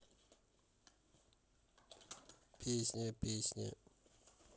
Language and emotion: Russian, neutral